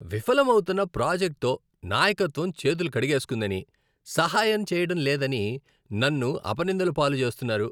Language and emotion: Telugu, disgusted